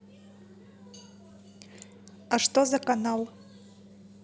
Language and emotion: Russian, neutral